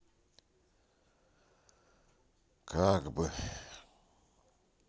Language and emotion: Russian, sad